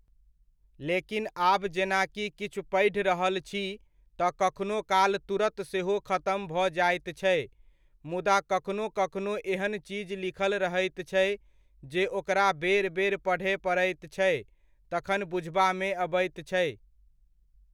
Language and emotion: Maithili, neutral